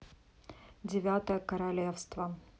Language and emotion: Russian, neutral